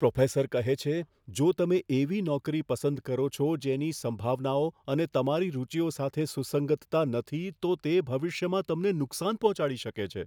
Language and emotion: Gujarati, fearful